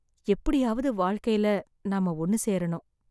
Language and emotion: Tamil, sad